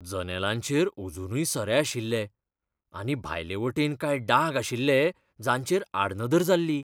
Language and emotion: Goan Konkani, fearful